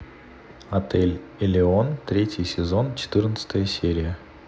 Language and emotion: Russian, neutral